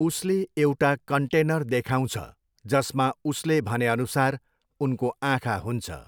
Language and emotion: Nepali, neutral